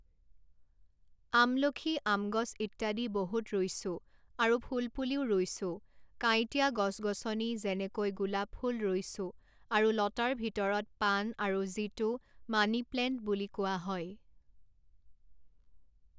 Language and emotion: Assamese, neutral